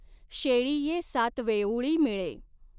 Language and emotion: Marathi, neutral